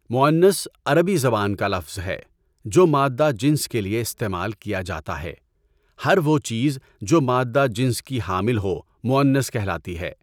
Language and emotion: Urdu, neutral